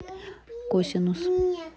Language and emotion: Russian, neutral